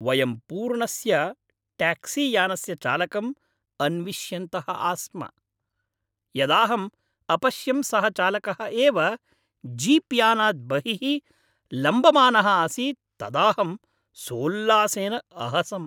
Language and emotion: Sanskrit, happy